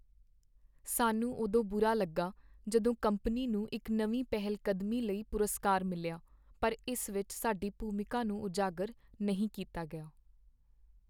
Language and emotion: Punjabi, sad